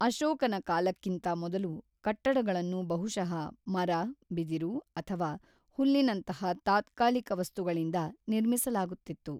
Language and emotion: Kannada, neutral